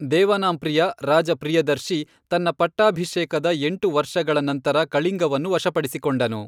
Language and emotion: Kannada, neutral